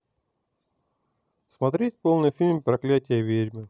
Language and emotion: Russian, neutral